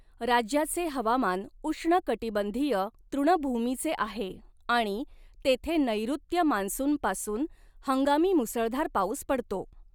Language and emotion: Marathi, neutral